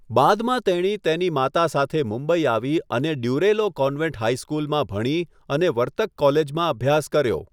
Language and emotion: Gujarati, neutral